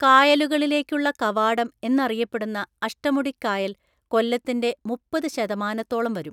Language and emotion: Malayalam, neutral